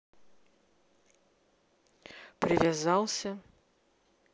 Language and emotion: Russian, neutral